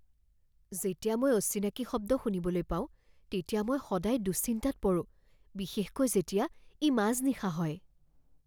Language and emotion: Assamese, fearful